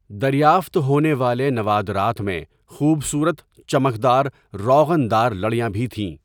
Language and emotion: Urdu, neutral